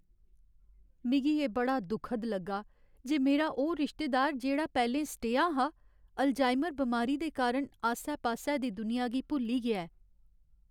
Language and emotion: Dogri, sad